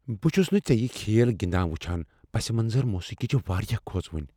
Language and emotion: Kashmiri, fearful